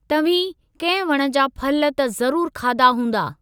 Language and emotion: Sindhi, neutral